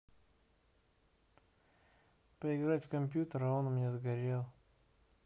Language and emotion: Russian, sad